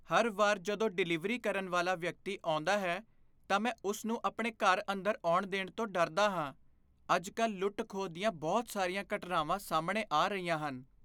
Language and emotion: Punjabi, fearful